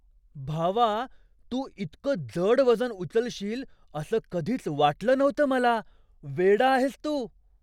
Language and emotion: Marathi, surprised